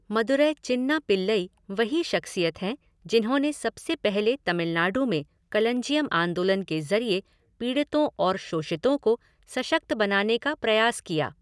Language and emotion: Hindi, neutral